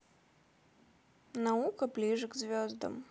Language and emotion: Russian, neutral